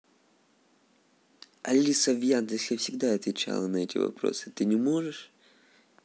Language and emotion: Russian, neutral